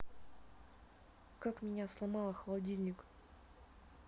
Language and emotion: Russian, neutral